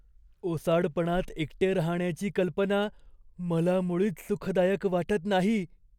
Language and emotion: Marathi, fearful